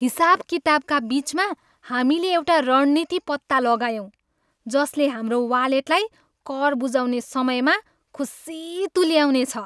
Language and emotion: Nepali, happy